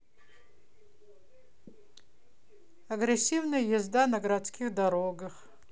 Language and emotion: Russian, neutral